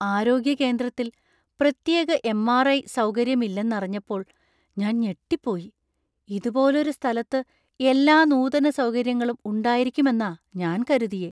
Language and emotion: Malayalam, surprised